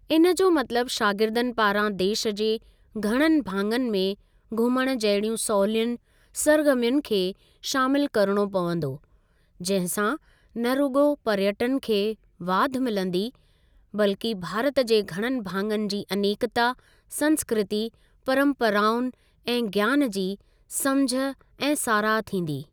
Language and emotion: Sindhi, neutral